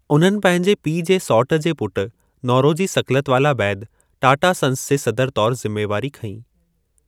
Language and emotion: Sindhi, neutral